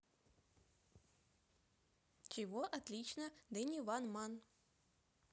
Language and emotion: Russian, positive